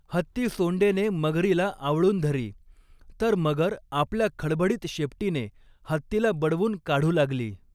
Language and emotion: Marathi, neutral